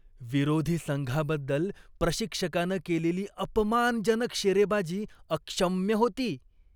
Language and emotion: Marathi, disgusted